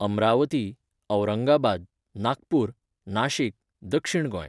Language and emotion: Goan Konkani, neutral